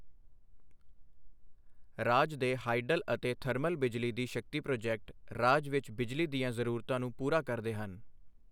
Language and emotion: Punjabi, neutral